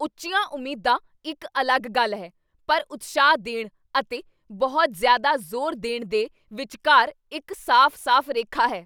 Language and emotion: Punjabi, angry